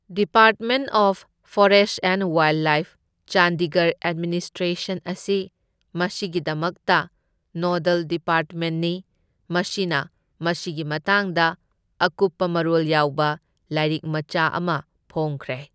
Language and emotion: Manipuri, neutral